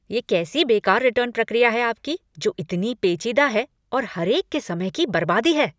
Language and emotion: Hindi, angry